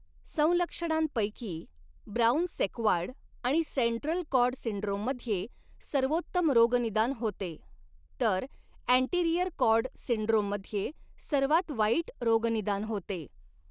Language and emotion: Marathi, neutral